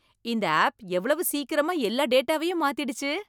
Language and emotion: Tamil, surprised